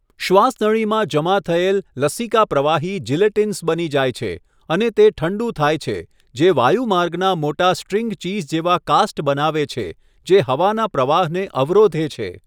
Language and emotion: Gujarati, neutral